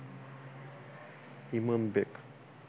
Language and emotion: Russian, neutral